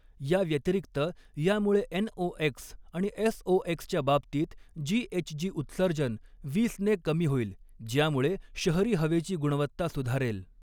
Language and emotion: Marathi, neutral